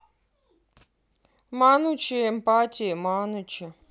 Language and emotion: Russian, angry